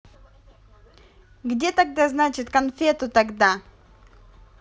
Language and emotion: Russian, angry